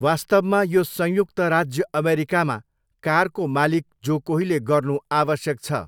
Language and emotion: Nepali, neutral